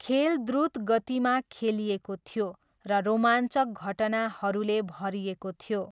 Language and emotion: Nepali, neutral